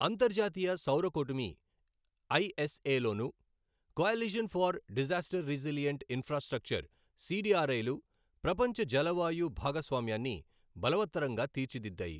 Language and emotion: Telugu, neutral